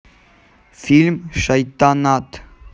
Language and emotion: Russian, neutral